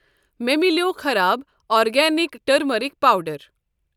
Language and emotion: Kashmiri, neutral